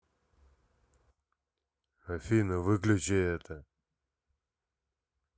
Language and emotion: Russian, neutral